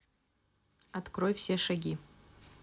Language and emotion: Russian, neutral